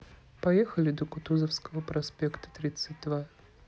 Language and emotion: Russian, neutral